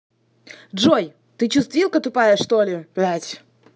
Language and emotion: Russian, angry